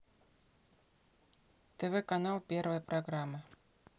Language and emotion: Russian, neutral